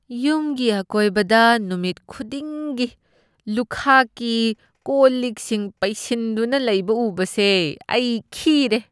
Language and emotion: Manipuri, disgusted